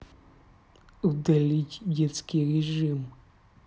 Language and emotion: Russian, angry